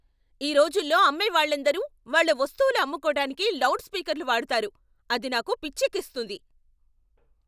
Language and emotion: Telugu, angry